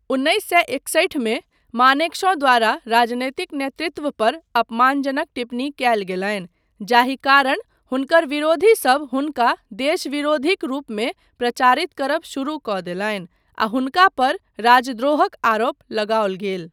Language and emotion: Maithili, neutral